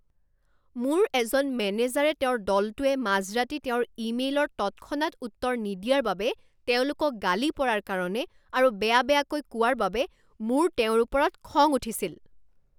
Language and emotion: Assamese, angry